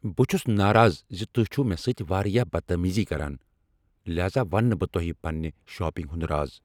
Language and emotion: Kashmiri, angry